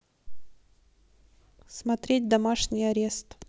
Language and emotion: Russian, neutral